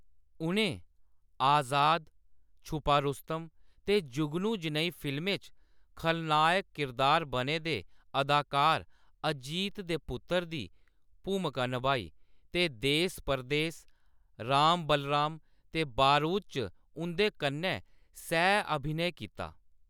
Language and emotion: Dogri, neutral